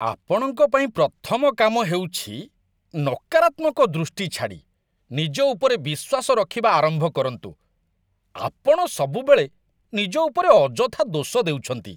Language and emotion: Odia, disgusted